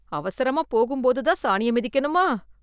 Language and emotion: Tamil, disgusted